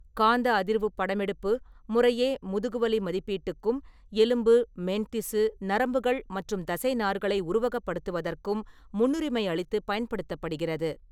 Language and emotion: Tamil, neutral